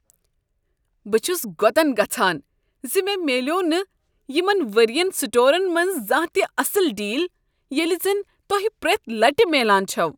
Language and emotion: Kashmiri, disgusted